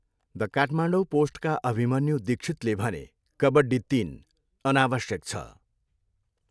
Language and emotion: Nepali, neutral